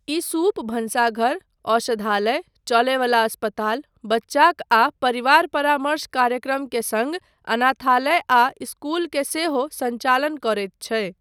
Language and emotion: Maithili, neutral